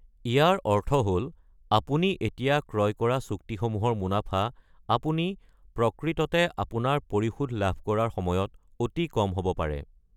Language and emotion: Assamese, neutral